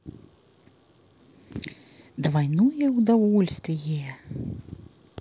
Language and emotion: Russian, positive